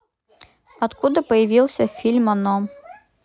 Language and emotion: Russian, neutral